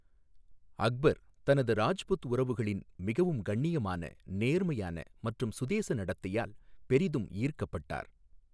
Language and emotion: Tamil, neutral